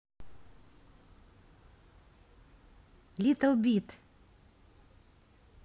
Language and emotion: Russian, neutral